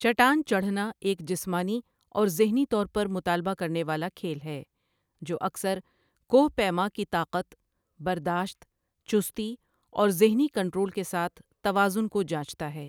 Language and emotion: Urdu, neutral